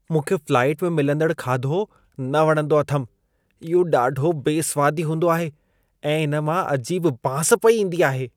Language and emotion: Sindhi, disgusted